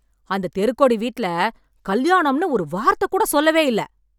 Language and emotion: Tamil, angry